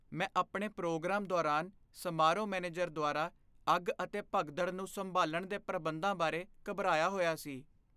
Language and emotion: Punjabi, fearful